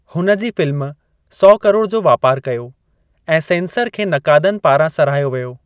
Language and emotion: Sindhi, neutral